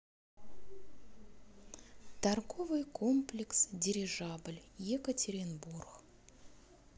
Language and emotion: Russian, neutral